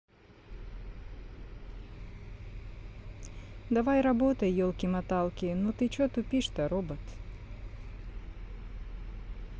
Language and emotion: Russian, neutral